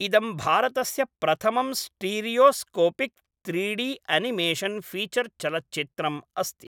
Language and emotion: Sanskrit, neutral